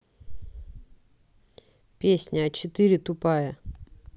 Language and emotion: Russian, neutral